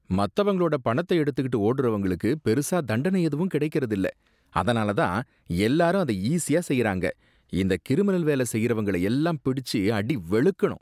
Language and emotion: Tamil, disgusted